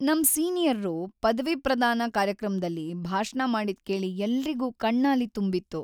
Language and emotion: Kannada, sad